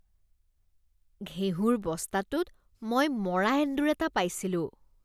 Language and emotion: Assamese, disgusted